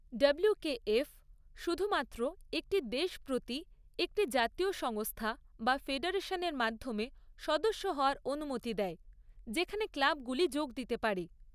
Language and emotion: Bengali, neutral